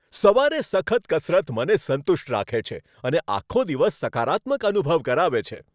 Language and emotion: Gujarati, happy